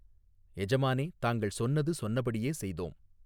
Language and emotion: Tamil, neutral